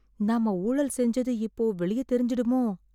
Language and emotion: Tamil, fearful